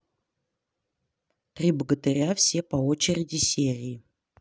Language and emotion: Russian, neutral